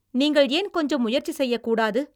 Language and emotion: Tamil, angry